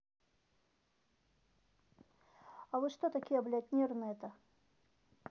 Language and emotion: Russian, angry